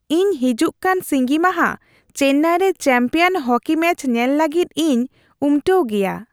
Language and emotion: Santali, happy